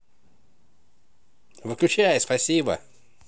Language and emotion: Russian, positive